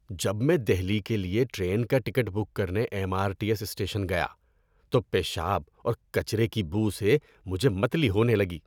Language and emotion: Urdu, disgusted